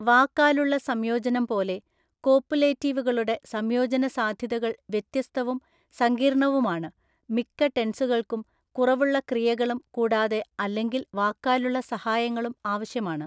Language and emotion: Malayalam, neutral